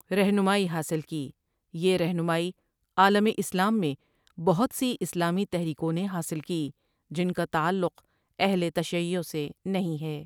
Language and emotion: Urdu, neutral